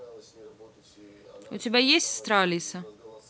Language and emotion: Russian, neutral